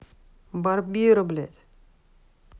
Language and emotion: Russian, angry